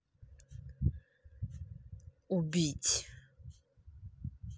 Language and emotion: Russian, angry